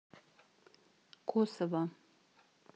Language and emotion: Russian, neutral